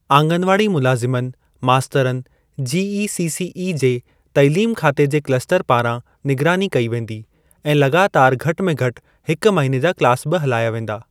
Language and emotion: Sindhi, neutral